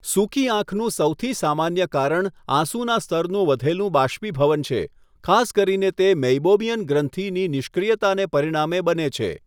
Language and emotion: Gujarati, neutral